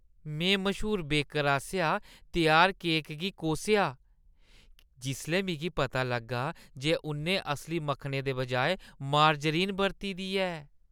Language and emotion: Dogri, disgusted